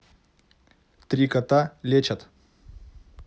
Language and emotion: Russian, neutral